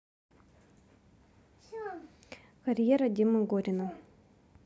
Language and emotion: Russian, neutral